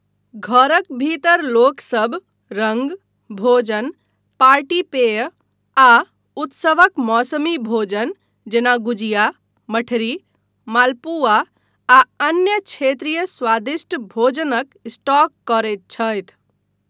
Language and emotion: Maithili, neutral